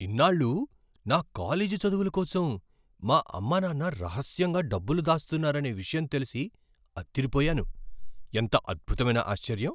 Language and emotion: Telugu, surprised